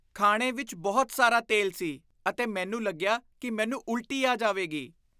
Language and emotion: Punjabi, disgusted